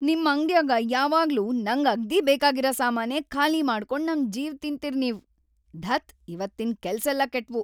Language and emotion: Kannada, angry